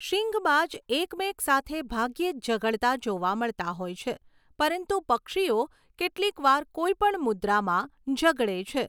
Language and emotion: Gujarati, neutral